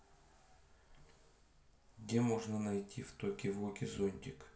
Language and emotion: Russian, neutral